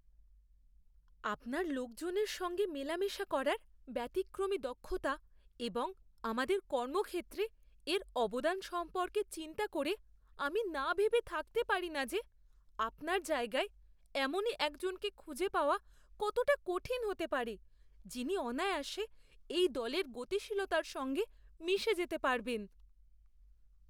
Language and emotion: Bengali, fearful